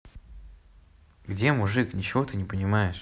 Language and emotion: Russian, neutral